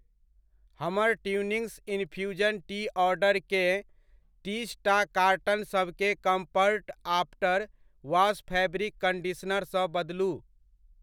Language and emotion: Maithili, neutral